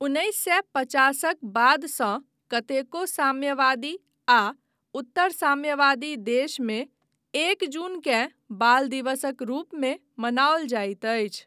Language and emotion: Maithili, neutral